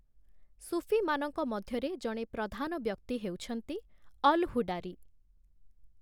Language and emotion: Odia, neutral